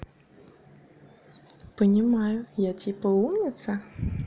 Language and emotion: Russian, positive